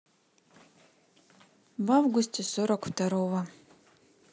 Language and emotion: Russian, neutral